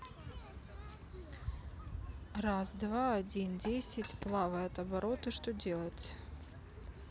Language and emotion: Russian, neutral